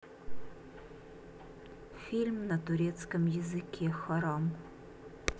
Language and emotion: Russian, neutral